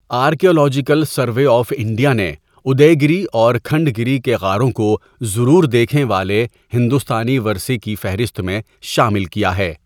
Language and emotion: Urdu, neutral